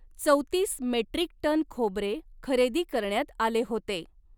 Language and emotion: Marathi, neutral